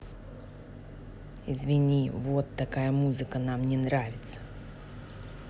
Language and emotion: Russian, angry